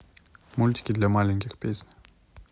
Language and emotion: Russian, neutral